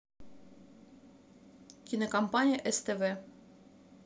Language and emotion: Russian, neutral